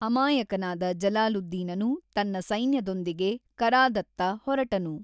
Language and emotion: Kannada, neutral